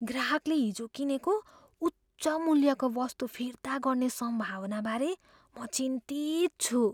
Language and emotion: Nepali, fearful